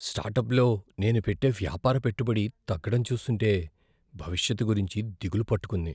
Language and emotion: Telugu, fearful